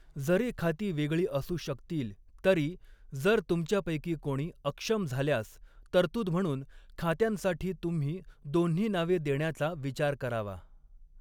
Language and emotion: Marathi, neutral